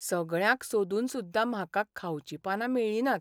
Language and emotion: Goan Konkani, sad